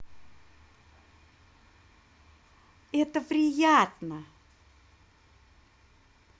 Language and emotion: Russian, positive